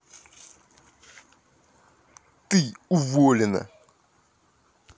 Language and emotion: Russian, angry